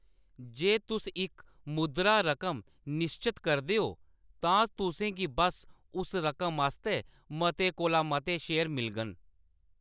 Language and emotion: Dogri, neutral